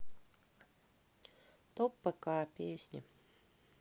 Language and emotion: Russian, sad